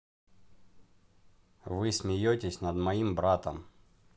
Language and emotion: Russian, neutral